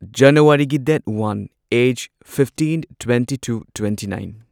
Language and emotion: Manipuri, neutral